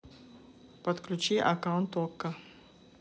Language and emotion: Russian, neutral